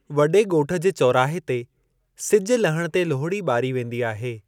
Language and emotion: Sindhi, neutral